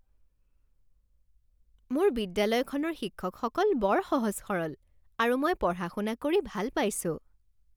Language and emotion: Assamese, happy